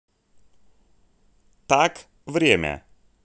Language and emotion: Russian, neutral